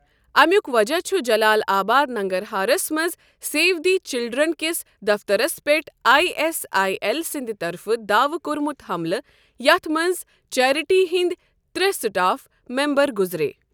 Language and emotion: Kashmiri, neutral